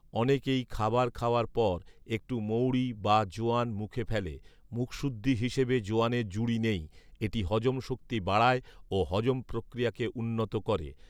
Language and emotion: Bengali, neutral